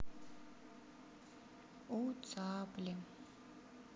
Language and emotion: Russian, sad